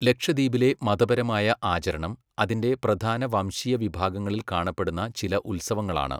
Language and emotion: Malayalam, neutral